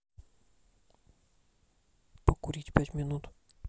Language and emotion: Russian, neutral